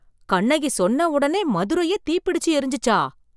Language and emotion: Tamil, surprised